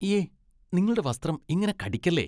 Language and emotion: Malayalam, disgusted